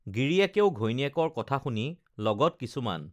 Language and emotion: Assamese, neutral